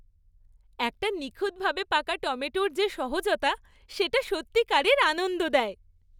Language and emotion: Bengali, happy